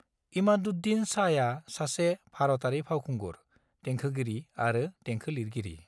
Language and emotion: Bodo, neutral